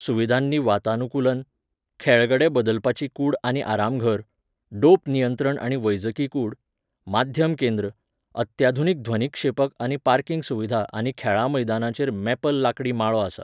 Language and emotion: Goan Konkani, neutral